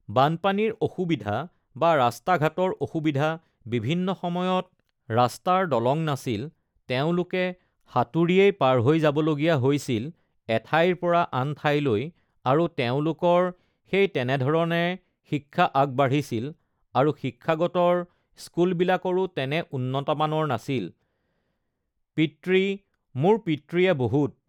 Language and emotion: Assamese, neutral